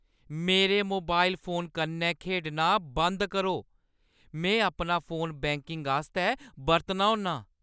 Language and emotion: Dogri, angry